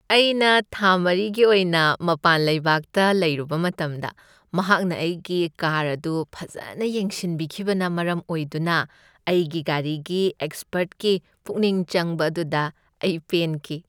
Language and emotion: Manipuri, happy